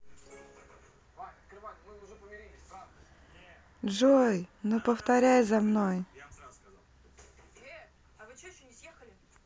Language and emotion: Russian, neutral